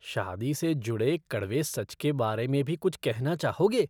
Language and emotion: Hindi, disgusted